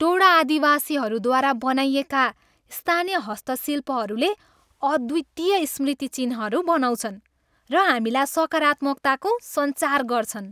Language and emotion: Nepali, happy